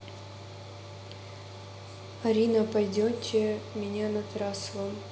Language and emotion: Russian, neutral